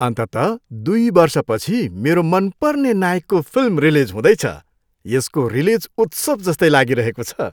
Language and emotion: Nepali, happy